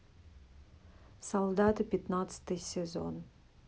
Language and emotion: Russian, neutral